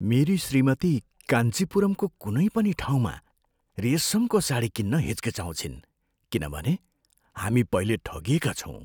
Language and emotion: Nepali, fearful